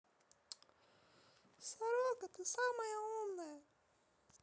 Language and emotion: Russian, neutral